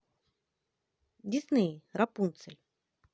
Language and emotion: Russian, neutral